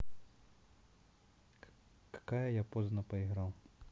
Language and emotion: Russian, neutral